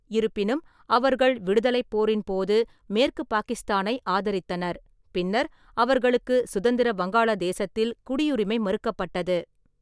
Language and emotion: Tamil, neutral